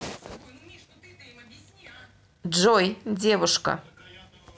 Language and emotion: Russian, neutral